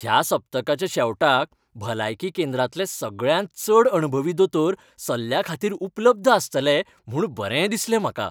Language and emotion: Goan Konkani, happy